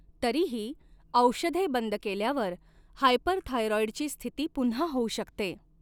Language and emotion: Marathi, neutral